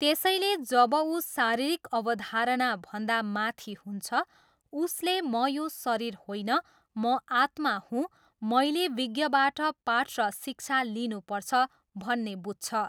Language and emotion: Nepali, neutral